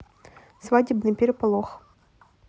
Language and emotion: Russian, neutral